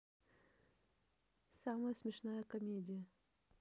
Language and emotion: Russian, neutral